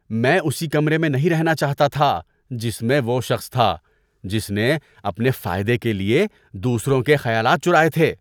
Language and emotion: Urdu, disgusted